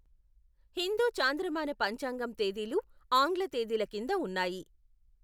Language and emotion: Telugu, neutral